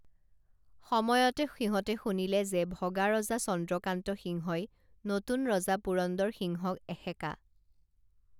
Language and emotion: Assamese, neutral